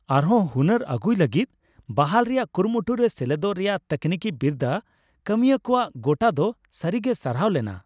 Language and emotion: Santali, happy